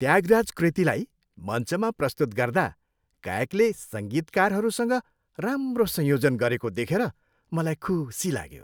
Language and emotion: Nepali, happy